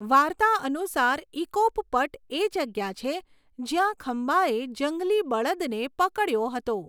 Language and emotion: Gujarati, neutral